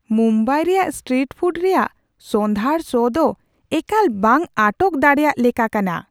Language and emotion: Santali, surprised